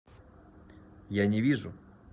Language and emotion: Russian, neutral